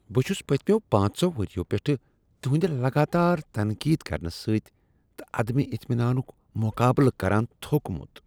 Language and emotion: Kashmiri, disgusted